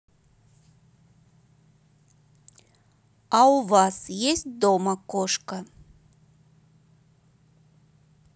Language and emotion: Russian, neutral